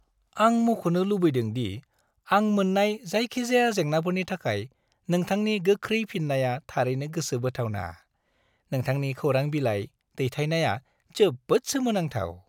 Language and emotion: Bodo, happy